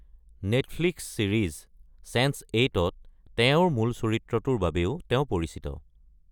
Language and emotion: Assamese, neutral